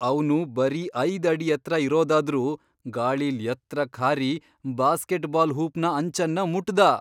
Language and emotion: Kannada, surprised